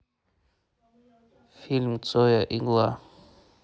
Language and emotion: Russian, neutral